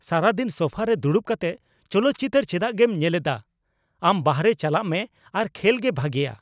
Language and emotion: Santali, angry